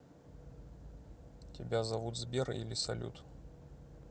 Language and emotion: Russian, neutral